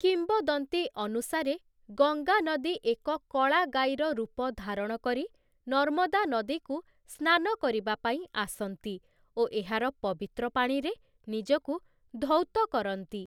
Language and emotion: Odia, neutral